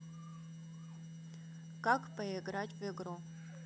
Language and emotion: Russian, neutral